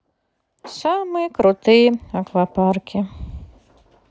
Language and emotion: Russian, sad